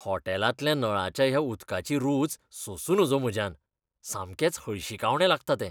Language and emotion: Goan Konkani, disgusted